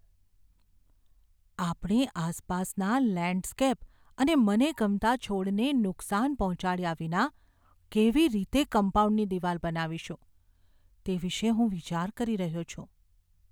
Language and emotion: Gujarati, fearful